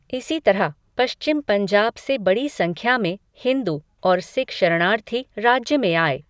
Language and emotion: Hindi, neutral